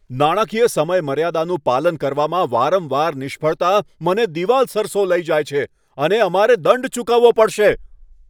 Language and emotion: Gujarati, angry